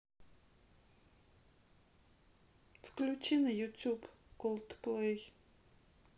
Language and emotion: Russian, sad